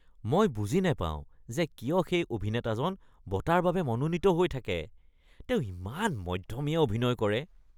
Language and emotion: Assamese, disgusted